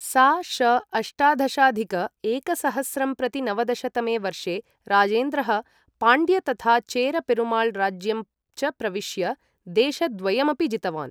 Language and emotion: Sanskrit, neutral